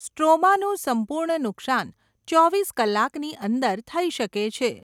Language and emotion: Gujarati, neutral